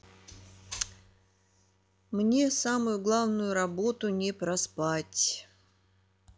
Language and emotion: Russian, neutral